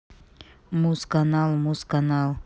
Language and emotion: Russian, neutral